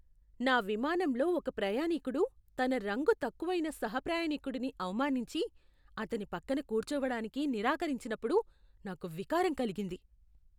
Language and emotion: Telugu, disgusted